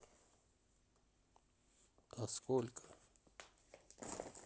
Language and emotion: Russian, sad